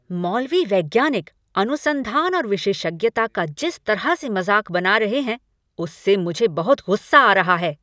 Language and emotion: Hindi, angry